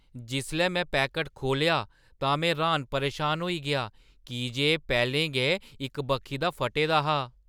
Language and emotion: Dogri, surprised